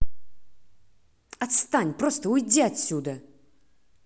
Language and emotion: Russian, angry